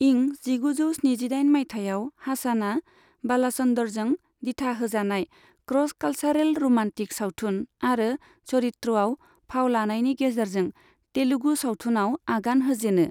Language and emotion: Bodo, neutral